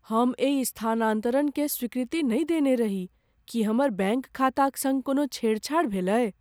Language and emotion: Maithili, fearful